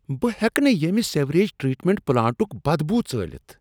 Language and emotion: Kashmiri, disgusted